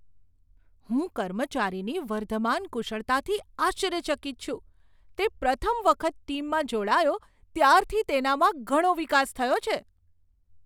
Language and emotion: Gujarati, surprised